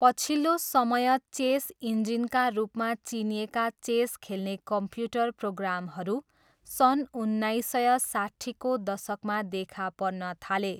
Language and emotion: Nepali, neutral